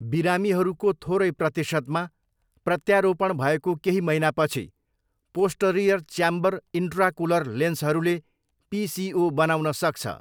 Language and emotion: Nepali, neutral